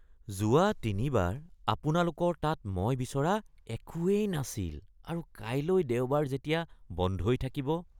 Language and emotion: Assamese, disgusted